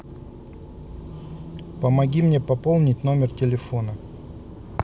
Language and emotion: Russian, neutral